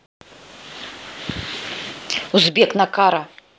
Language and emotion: Russian, angry